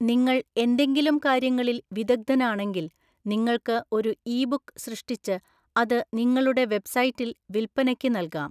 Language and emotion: Malayalam, neutral